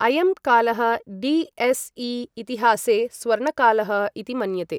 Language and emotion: Sanskrit, neutral